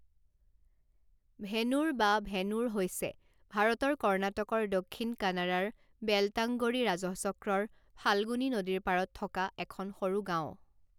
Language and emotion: Assamese, neutral